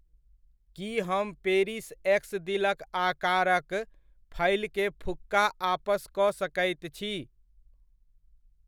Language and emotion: Maithili, neutral